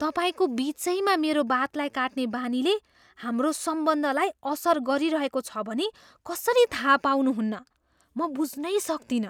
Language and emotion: Nepali, surprised